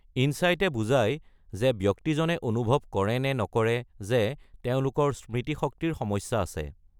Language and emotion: Assamese, neutral